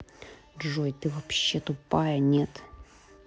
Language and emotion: Russian, angry